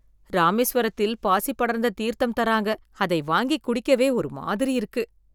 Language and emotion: Tamil, disgusted